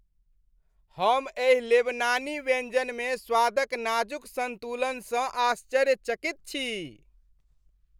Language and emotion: Maithili, happy